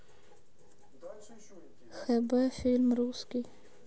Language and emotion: Russian, sad